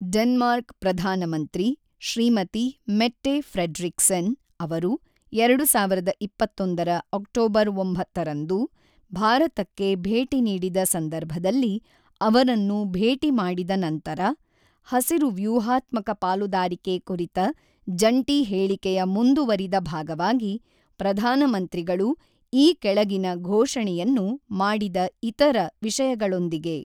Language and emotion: Kannada, neutral